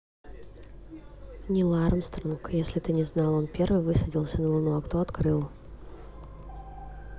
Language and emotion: Russian, neutral